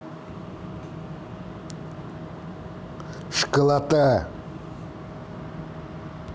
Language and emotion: Russian, angry